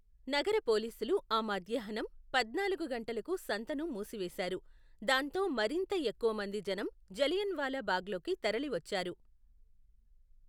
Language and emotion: Telugu, neutral